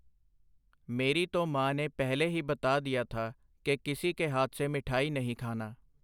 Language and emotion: Punjabi, neutral